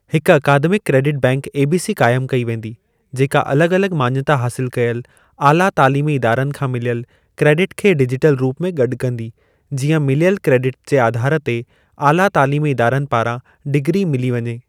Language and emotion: Sindhi, neutral